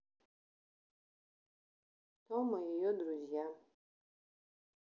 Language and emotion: Russian, sad